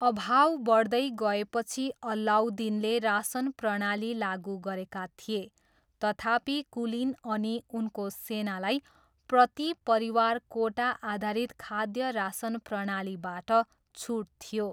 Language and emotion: Nepali, neutral